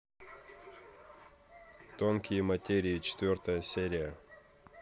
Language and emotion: Russian, neutral